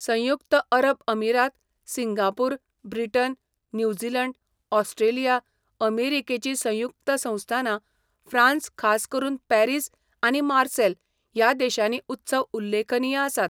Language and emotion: Goan Konkani, neutral